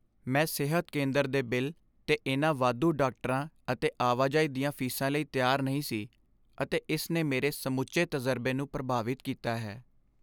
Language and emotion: Punjabi, sad